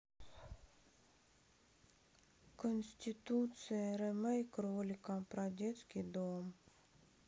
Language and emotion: Russian, sad